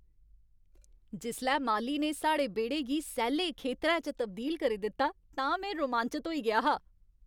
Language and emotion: Dogri, happy